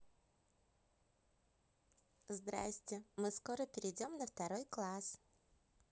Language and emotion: Russian, positive